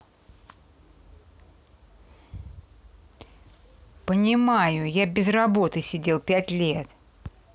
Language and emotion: Russian, angry